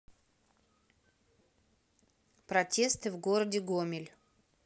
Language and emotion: Russian, neutral